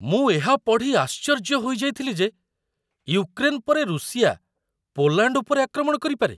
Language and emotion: Odia, surprised